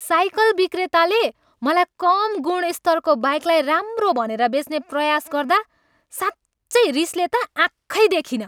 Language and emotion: Nepali, angry